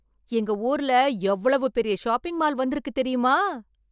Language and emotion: Tamil, surprised